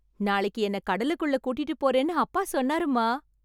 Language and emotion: Tamil, happy